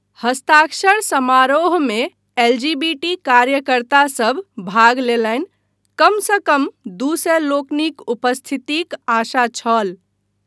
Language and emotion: Maithili, neutral